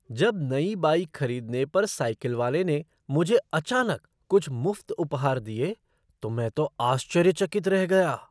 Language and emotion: Hindi, surprised